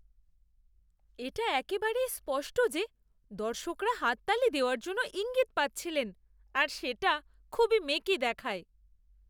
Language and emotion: Bengali, disgusted